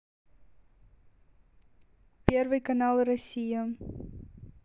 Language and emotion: Russian, neutral